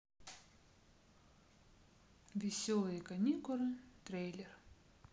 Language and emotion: Russian, neutral